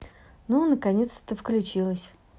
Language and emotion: Russian, positive